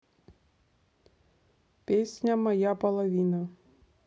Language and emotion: Russian, neutral